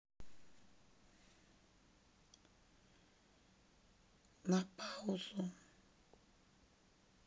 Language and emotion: Russian, sad